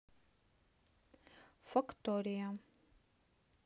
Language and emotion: Russian, neutral